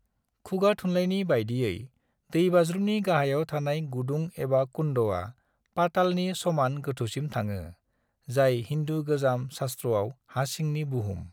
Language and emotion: Bodo, neutral